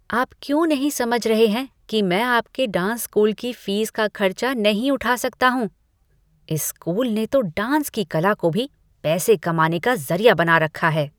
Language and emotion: Hindi, disgusted